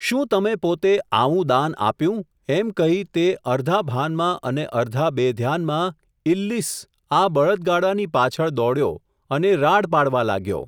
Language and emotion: Gujarati, neutral